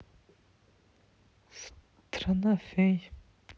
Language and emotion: Russian, neutral